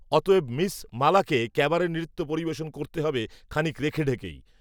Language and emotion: Bengali, neutral